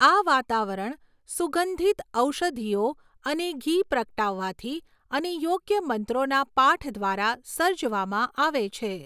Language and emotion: Gujarati, neutral